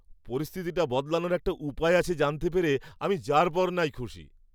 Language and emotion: Bengali, happy